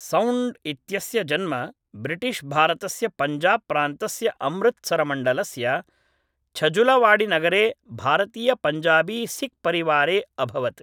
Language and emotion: Sanskrit, neutral